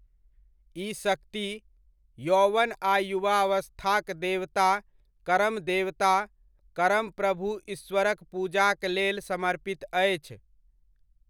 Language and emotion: Maithili, neutral